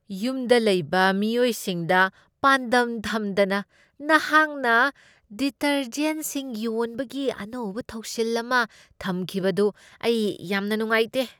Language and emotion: Manipuri, disgusted